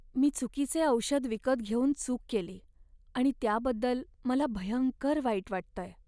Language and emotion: Marathi, sad